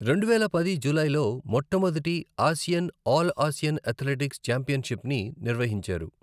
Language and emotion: Telugu, neutral